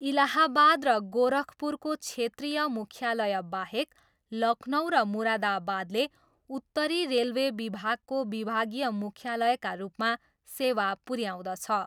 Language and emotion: Nepali, neutral